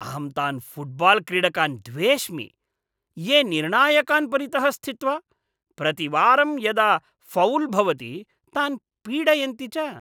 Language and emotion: Sanskrit, disgusted